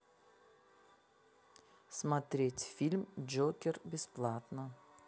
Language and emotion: Russian, neutral